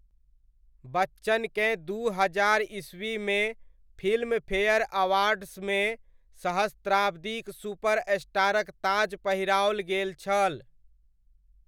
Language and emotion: Maithili, neutral